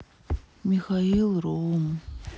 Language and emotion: Russian, sad